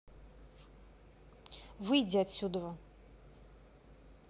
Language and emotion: Russian, angry